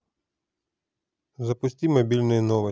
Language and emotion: Russian, neutral